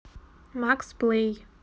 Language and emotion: Russian, neutral